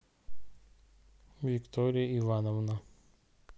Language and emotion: Russian, neutral